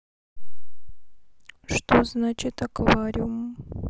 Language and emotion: Russian, neutral